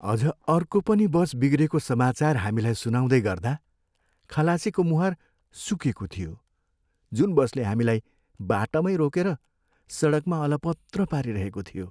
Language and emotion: Nepali, sad